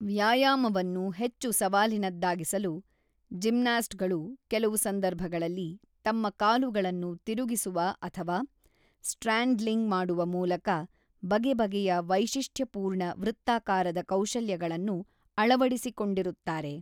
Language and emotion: Kannada, neutral